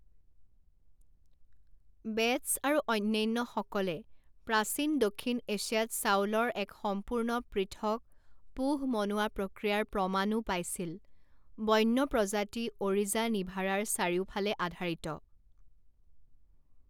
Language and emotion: Assamese, neutral